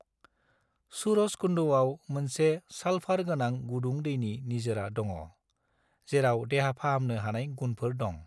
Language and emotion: Bodo, neutral